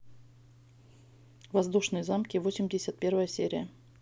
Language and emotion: Russian, neutral